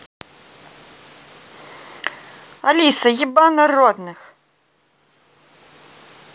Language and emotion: Russian, angry